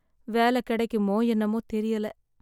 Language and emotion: Tamil, sad